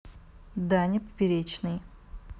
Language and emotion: Russian, neutral